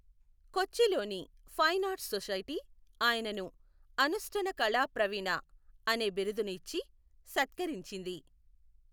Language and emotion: Telugu, neutral